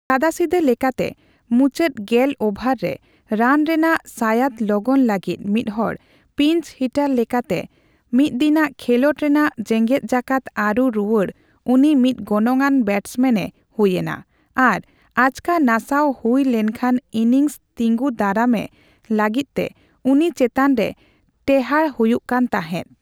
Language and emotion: Santali, neutral